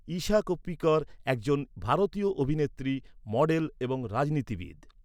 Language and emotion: Bengali, neutral